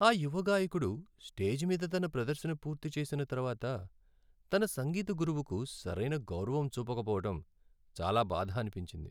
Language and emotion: Telugu, sad